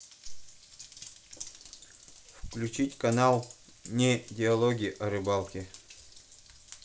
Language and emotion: Russian, neutral